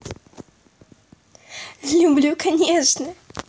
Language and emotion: Russian, positive